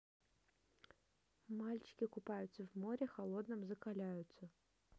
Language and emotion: Russian, neutral